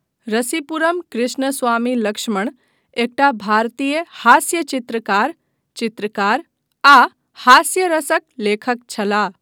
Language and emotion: Maithili, neutral